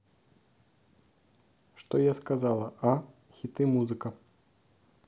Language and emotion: Russian, neutral